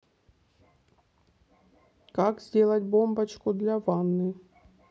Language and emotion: Russian, neutral